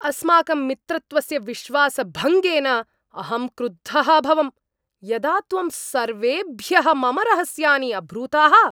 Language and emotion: Sanskrit, angry